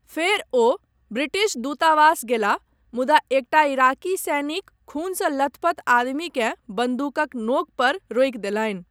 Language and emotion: Maithili, neutral